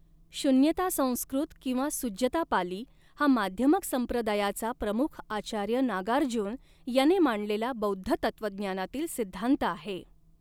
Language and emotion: Marathi, neutral